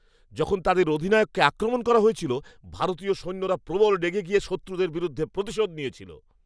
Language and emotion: Bengali, angry